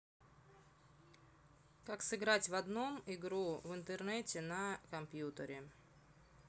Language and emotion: Russian, neutral